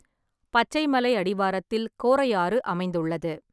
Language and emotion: Tamil, neutral